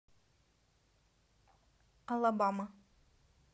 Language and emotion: Russian, neutral